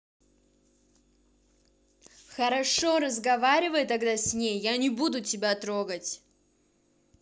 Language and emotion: Russian, angry